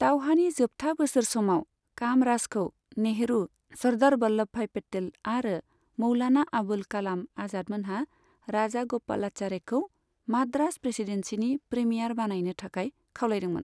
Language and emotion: Bodo, neutral